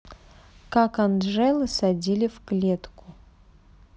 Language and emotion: Russian, neutral